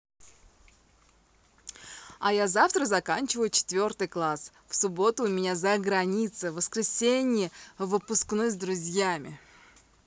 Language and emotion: Russian, positive